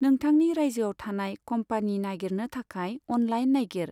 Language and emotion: Bodo, neutral